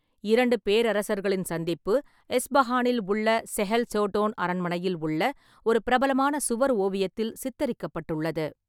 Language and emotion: Tamil, neutral